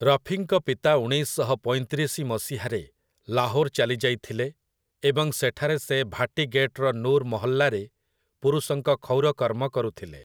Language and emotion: Odia, neutral